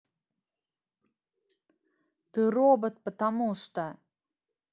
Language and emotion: Russian, angry